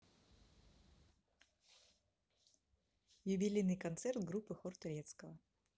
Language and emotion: Russian, neutral